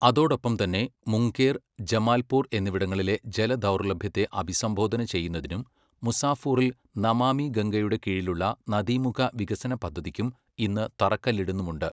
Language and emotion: Malayalam, neutral